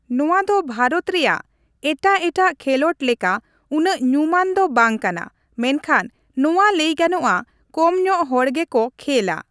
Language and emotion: Santali, neutral